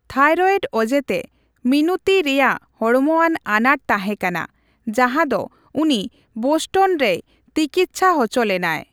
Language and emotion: Santali, neutral